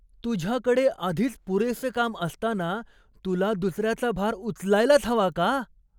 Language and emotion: Marathi, surprised